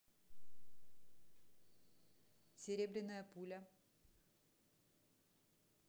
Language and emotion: Russian, neutral